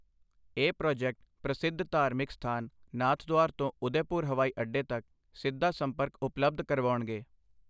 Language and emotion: Punjabi, neutral